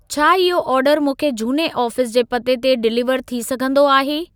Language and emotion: Sindhi, neutral